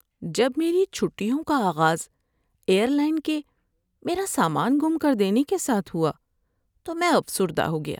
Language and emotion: Urdu, sad